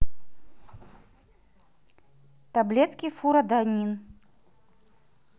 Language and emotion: Russian, neutral